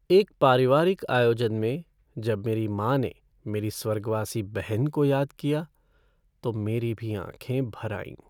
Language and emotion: Hindi, sad